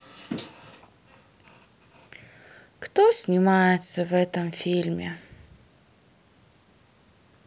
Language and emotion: Russian, sad